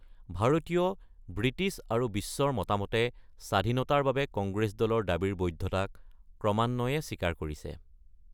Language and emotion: Assamese, neutral